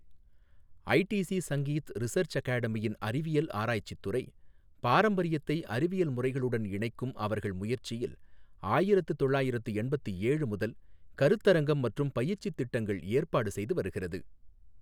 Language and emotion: Tamil, neutral